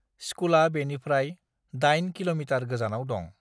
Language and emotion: Bodo, neutral